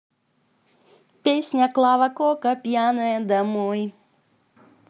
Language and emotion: Russian, positive